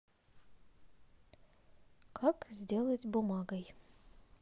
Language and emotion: Russian, neutral